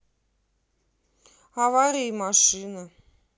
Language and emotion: Russian, neutral